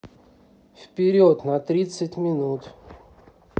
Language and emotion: Russian, neutral